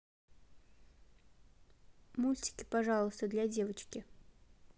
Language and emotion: Russian, neutral